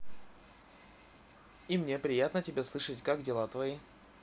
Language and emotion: Russian, positive